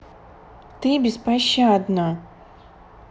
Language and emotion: Russian, neutral